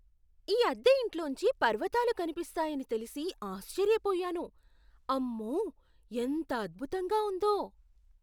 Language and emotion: Telugu, surprised